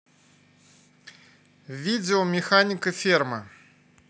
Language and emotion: Russian, neutral